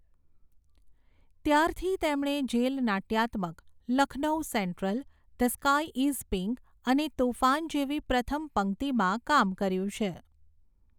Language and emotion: Gujarati, neutral